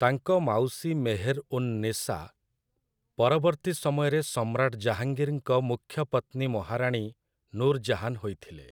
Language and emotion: Odia, neutral